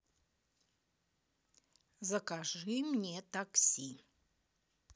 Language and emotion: Russian, neutral